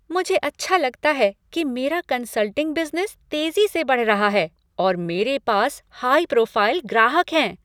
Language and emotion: Hindi, happy